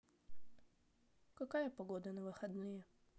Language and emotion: Russian, neutral